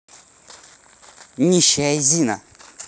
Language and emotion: Russian, angry